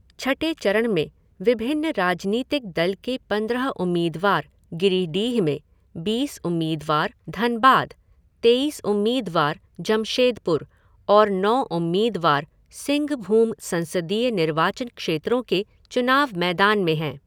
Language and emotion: Hindi, neutral